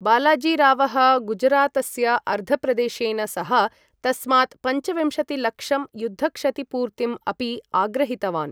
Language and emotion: Sanskrit, neutral